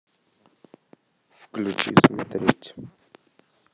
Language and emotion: Russian, neutral